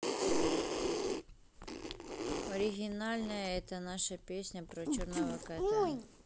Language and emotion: Russian, neutral